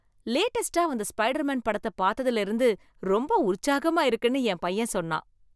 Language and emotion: Tamil, happy